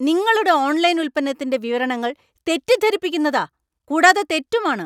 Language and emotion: Malayalam, angry